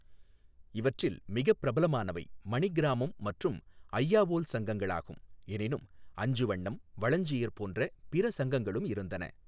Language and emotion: Tamil, neutral